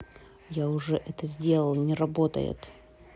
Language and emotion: Russian, angry